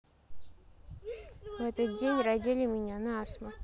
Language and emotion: Russian, neutral